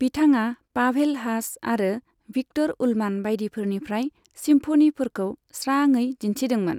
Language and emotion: Bodo, neutral